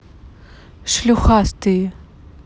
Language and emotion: Russian, angry